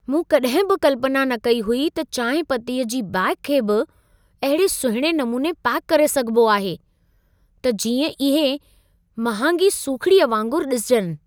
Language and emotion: Sindhi, surprised